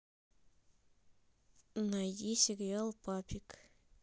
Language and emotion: Russian, neutral